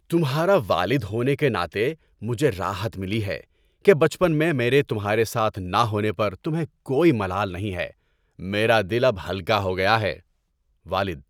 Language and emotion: Urdu, happy